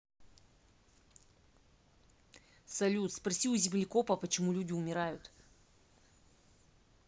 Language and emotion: Russian, angry